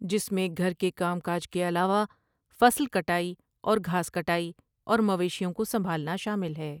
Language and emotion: Urdu, neutral